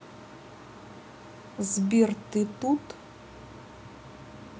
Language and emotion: Russian, neutral